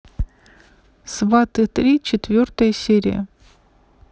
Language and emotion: Russian, neutral